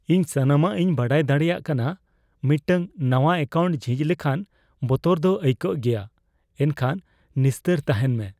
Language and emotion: Santali, fearful